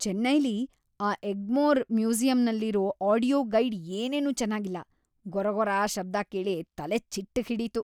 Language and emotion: Kannada, disgusted